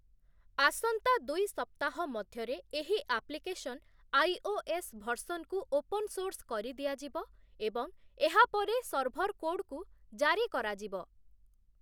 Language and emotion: Odia, neutral